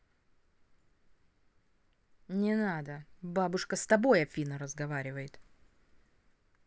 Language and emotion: Russian, angry